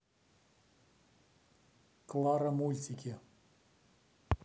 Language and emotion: Russian, neutral